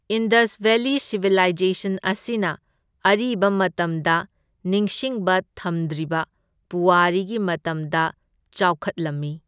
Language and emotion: Manipuri, neutral